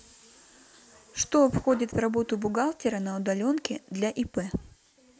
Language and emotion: Russian, neutral